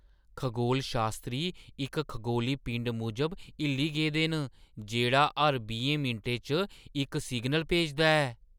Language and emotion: Dogri, surprised